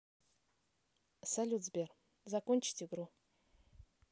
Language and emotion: Russian, neutral